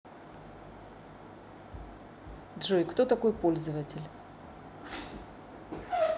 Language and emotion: Russian, neutral